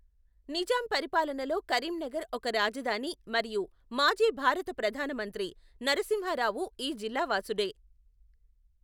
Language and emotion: Telugu, neutral